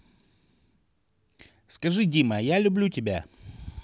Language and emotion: Russian, neutral